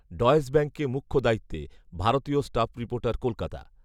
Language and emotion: Bengali, neutral